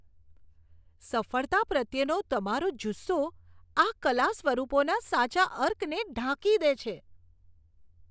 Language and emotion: Gujarati, disgusted